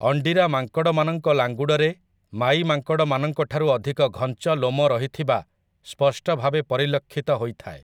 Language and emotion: Odia, neutral